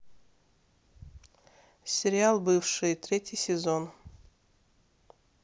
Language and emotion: Russian, neutral